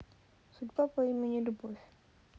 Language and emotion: Russian, neutral